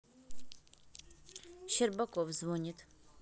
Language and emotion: Russian, neutral